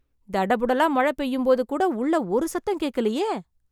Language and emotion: Tamil, surprised